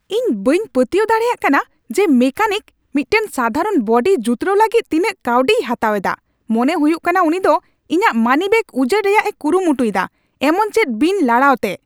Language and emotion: Santali, angry